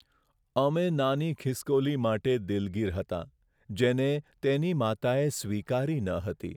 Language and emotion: Gujarati, sad